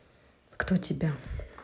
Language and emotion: Russian, neutral